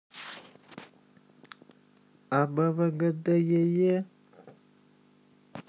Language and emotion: Russian, positive